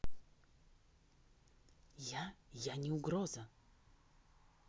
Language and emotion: Russian, neutral